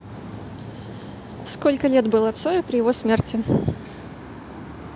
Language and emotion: Russian, neutral